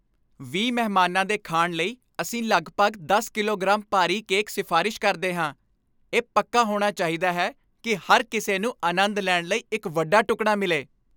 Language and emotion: Punjabi, happy